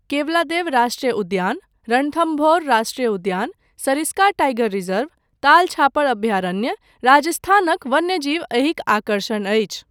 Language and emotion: Maithili, neutral